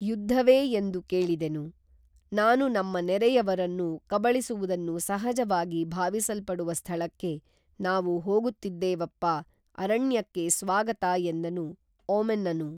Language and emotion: Kannada, neutral